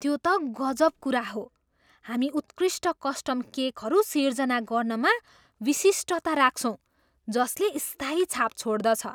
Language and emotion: Nepali, surprised